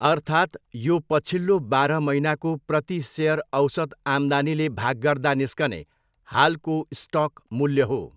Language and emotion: Nepali, neutral